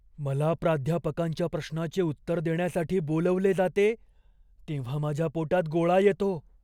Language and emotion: Marathi, fearful